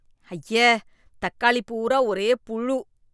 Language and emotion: Tamil, disgusted